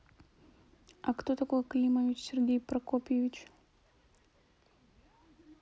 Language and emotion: Russian, neutral